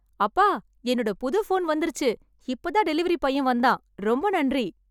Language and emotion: Tamil, happy